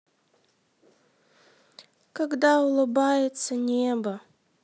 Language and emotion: Russian, sad